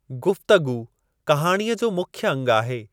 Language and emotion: Sindhi, neutral